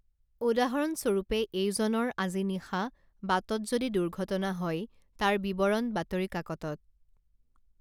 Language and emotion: Assamese, neutral